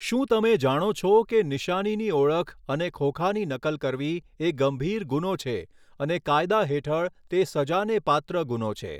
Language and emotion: Gujarati, neutral